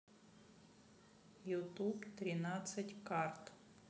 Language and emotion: Russian, neutral